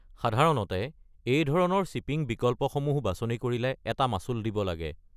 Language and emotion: Assamese, neutral